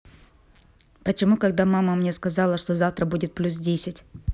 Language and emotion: Russian, neutral